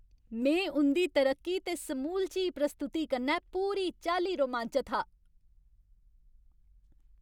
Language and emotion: Dogri, happy